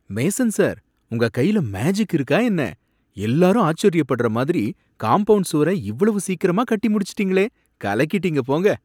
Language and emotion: Tamil, surprised